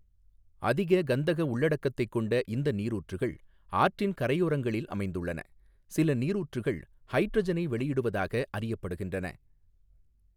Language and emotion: Tamil, neutral